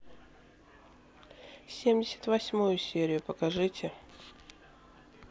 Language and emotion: Russian, neutral